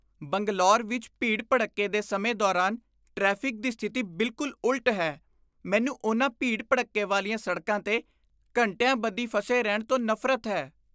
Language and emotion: Punjabi, disgusted